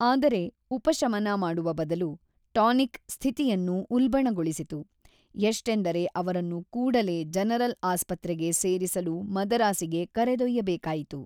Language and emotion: Kannada, neutral